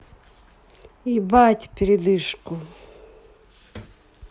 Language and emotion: Russian, neutral